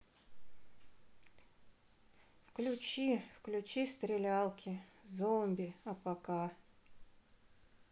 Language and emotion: Russian, sad